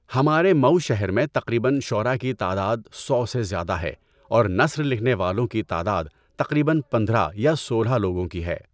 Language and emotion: Urdu, neutral